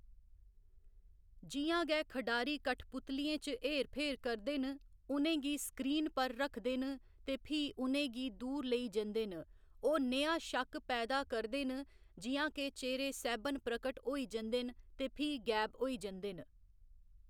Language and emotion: Dogri, neutral